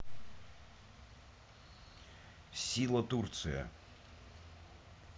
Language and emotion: Russian, neutral